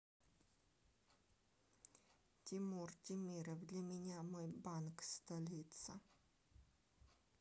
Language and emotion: Russian, neutral